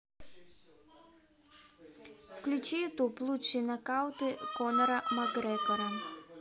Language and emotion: Russian, neutral